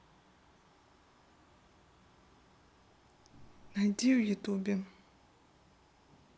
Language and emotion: Russian, neutral